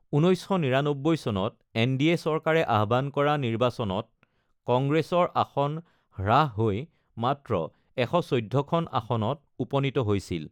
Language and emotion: Assamese, neutral